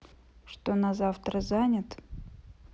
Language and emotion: Russian, neutral